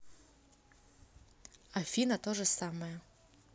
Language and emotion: Russian, neutral